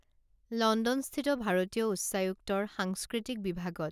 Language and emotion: Assamese, neutral